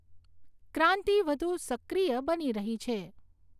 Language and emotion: Gujarati, neutral